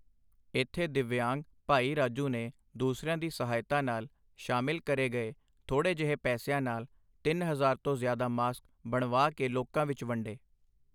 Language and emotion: Punjabi, neutral